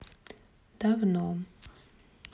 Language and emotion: Russian, sad